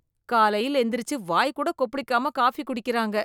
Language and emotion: Tamil, disgusted